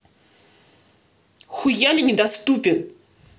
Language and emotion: Russian, angry